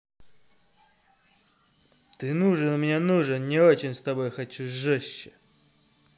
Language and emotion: Russian, angry